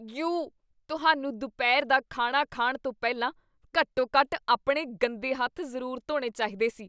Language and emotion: Punjabi, disgusted